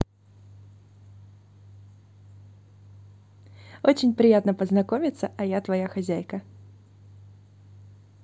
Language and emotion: Russian, positive